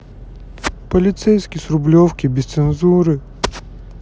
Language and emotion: Russian, sad